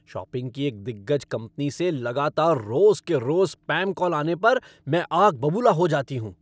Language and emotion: Hindi, angry